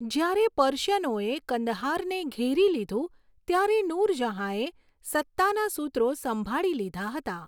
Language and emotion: Gujarati, neutral